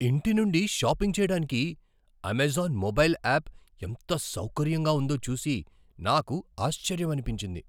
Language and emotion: Telugu, surprised